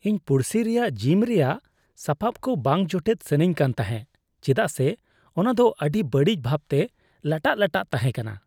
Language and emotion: Santali, disgusted